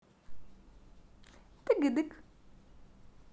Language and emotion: Russian, positive